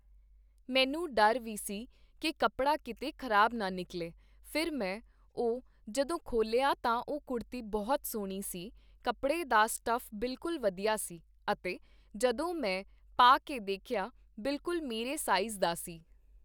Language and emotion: Punjabi, neutral